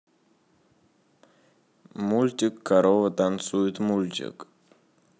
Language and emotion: Russian, neutral